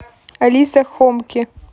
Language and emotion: Russian, neutral